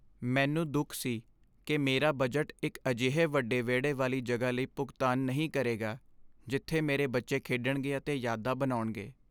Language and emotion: Punjabi, sad